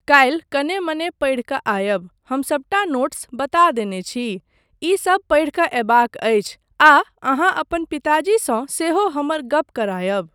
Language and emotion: Maithili, neutral